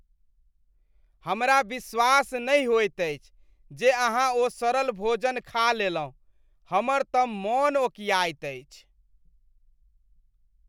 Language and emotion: Maithili, disgusted